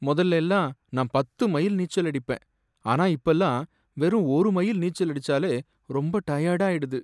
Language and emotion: Tamil, sad